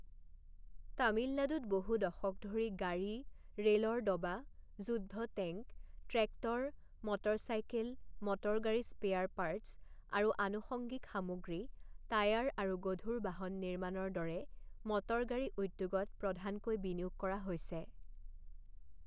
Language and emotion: Assamese, neutral